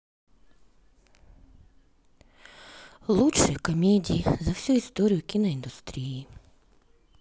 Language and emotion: Russian, sad